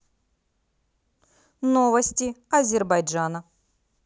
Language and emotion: Russian, positive